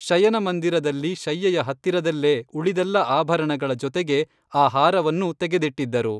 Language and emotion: Kannada, neutral